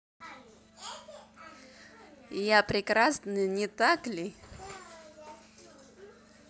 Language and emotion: Russian, positive